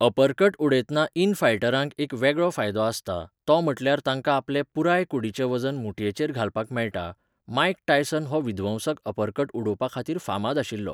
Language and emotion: Goan Konkani, neutral